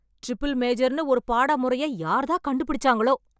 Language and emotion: Tamil, angry